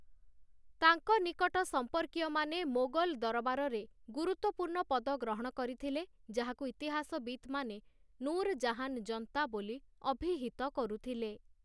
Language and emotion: Odia, neutral